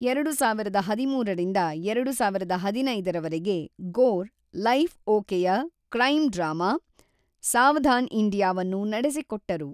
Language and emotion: Kannada, neutral